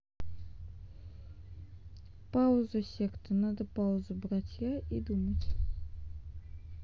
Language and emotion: Russian, sad